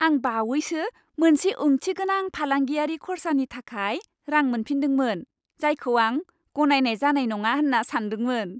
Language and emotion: Bodo, happy